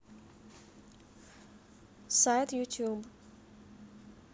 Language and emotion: Russian, neutral